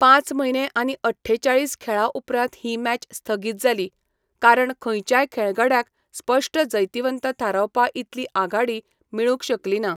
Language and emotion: Goan Konkani, neutral